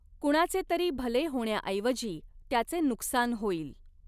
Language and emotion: Marathi, neutral